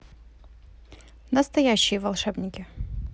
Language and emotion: Russian, neutral